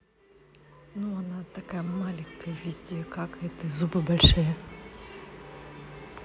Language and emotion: Russian, neutral